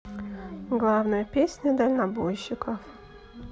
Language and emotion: Russian, neutral